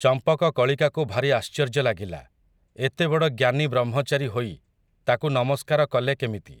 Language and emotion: Odia, neutral